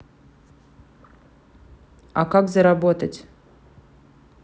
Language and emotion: Russian, neutral